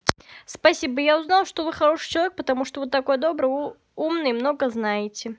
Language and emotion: Russian, positive